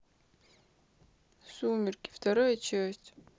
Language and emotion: Russian, sad